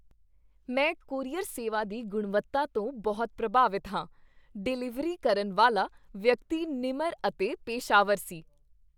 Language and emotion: Punjabi, happy